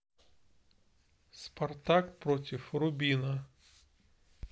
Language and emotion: Russian, neutral